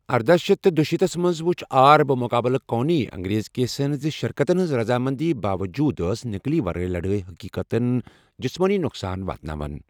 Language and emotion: Kashmiri, neutral